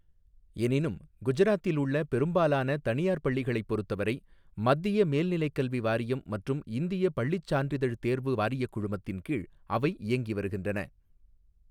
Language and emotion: Tamil, neutral